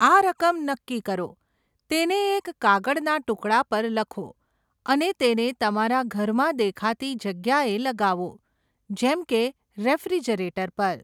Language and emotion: Gujarati, neutral